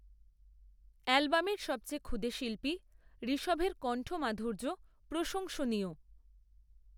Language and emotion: Bengali, neutral